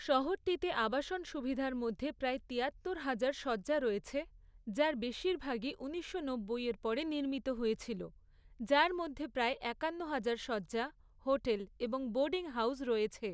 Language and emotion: Bengali, neutral